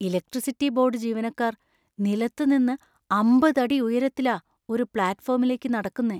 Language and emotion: Malayalam, fearful